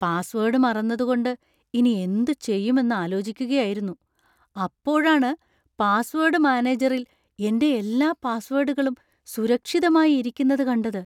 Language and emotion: Malayalam, surprised